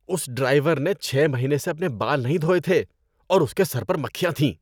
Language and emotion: Urdu, disgusted